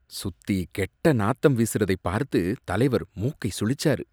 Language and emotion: Tamil, disgusted